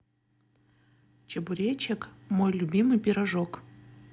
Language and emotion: Russian, positive